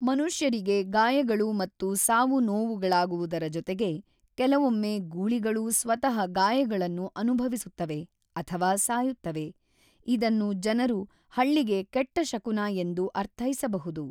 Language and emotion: Kannada, neutral